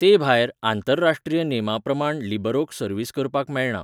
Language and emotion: Goan Konkani, neutral